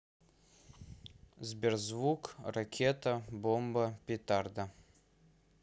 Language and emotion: Russian, neutral